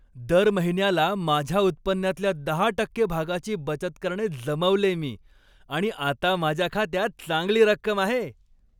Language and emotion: Marathi, happy